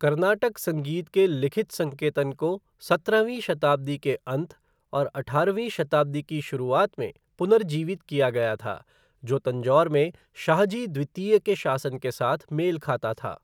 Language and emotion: Hindi, neutral